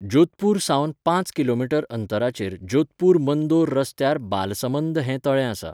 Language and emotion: Goan Konkani, neutral